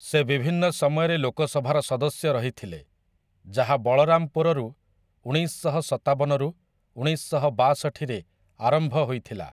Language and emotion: Odia, neutral